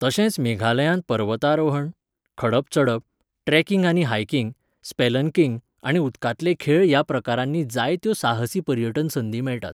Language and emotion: Goan Konkani, neutral